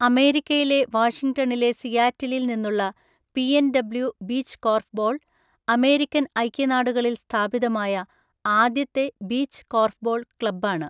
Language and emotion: Malayalam, neutral